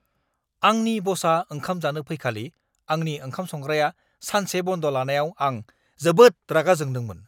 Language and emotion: Bodo, angry